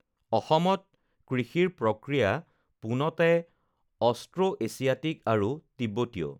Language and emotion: Assamese, neutral